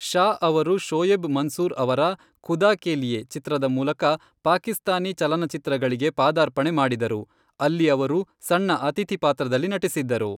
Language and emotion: Kannada, neutral